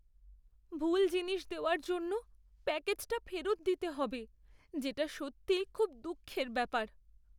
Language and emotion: Bengali, sad